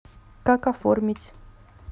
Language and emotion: Russian, neutral